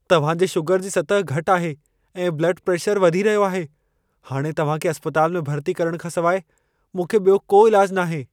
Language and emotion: Sindhi, fearful